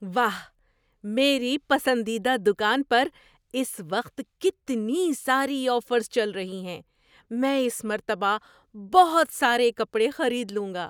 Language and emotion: Urdu, surprised